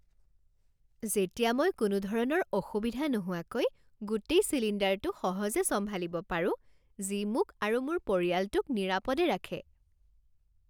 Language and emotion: Assamese, happy